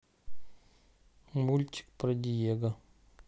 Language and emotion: Russian, sad